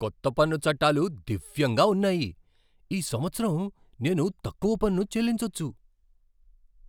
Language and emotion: Telugu, surprised